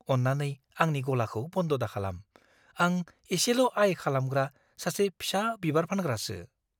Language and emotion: Bodo, fearful